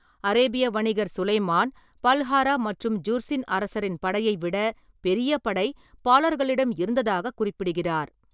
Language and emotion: Tamil, neutral